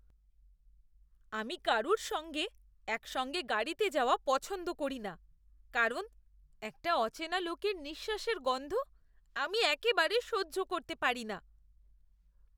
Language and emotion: Bengali, disgusted